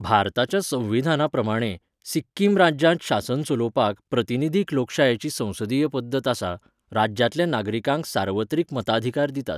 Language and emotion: Goan Konkani, neutral